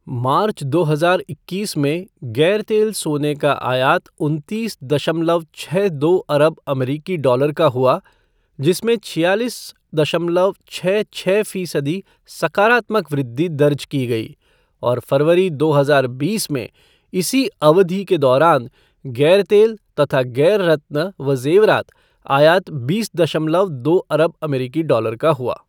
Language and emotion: Hindi, neutral